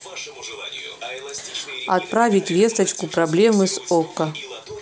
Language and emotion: Russian, neutral